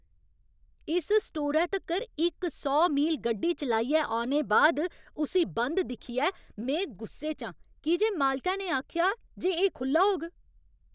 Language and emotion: Dogri, angry